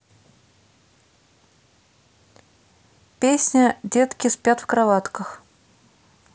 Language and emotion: Russian, neutral